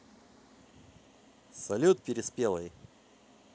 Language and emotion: Russian, positive